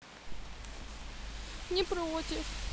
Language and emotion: Russian, sad